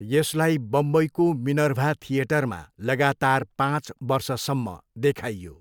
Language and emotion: Nepali, neutral